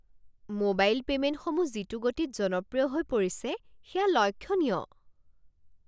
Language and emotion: Assamese, surprised